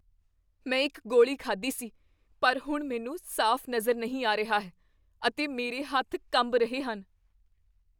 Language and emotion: Punjabi, fearful